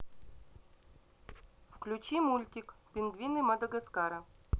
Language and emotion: Russian, neutral